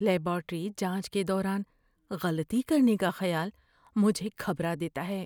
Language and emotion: Urdu, fearful